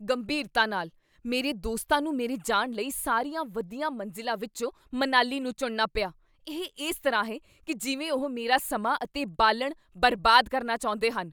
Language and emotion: Punjabi, angry